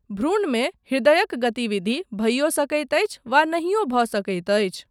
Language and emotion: Maithili, neutral